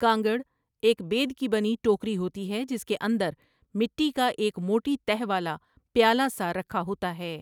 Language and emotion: Urdu, neutral